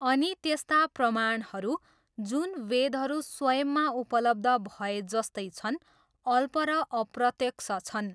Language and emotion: Nepali, neutral